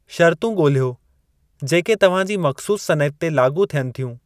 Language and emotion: Sindhi, neutral